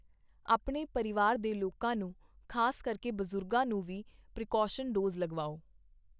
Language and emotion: Punjabi, neutral